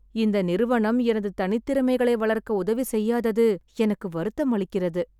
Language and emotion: Tamil, sad